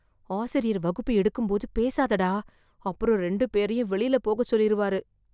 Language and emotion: Tamil, fearful